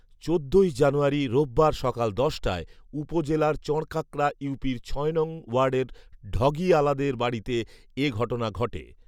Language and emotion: Bengali, neutral